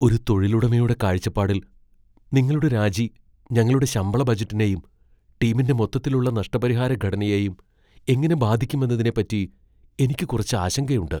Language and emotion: Malayalam, fearful